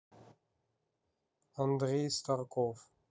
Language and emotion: Russian, neutral